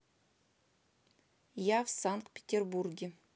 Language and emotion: Russian, neutral